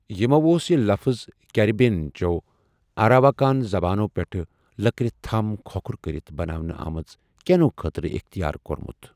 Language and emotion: Kashmiri, neutral